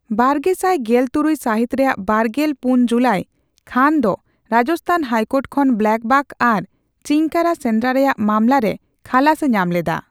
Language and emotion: Santali, neutral